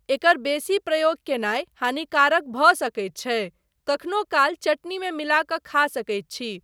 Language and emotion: Maithili, neutral